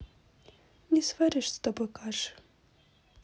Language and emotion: Russian, sad